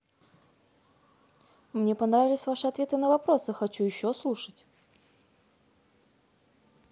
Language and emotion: Russian, neutral